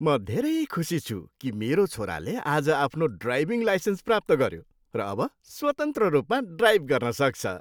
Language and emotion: Nepali, happy